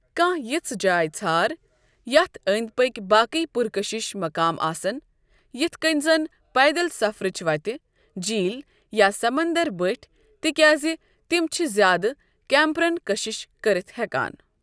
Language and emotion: Kashmiri, neutral